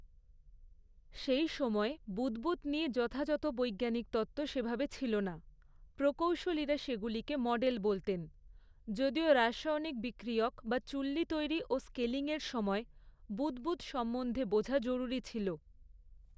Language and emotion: Bengali, neutral